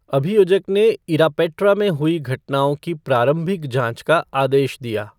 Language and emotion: Hindi, neutral